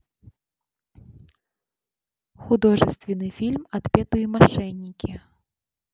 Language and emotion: Russian, neutral